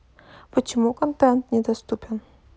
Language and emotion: Russian, neutral